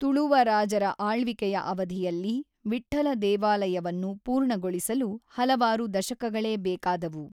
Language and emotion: Kannada, neutral